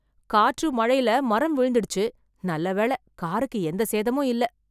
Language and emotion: Tamil, surprised